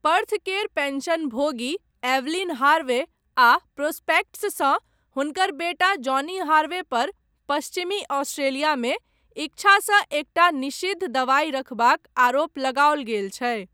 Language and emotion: Maithili, neutral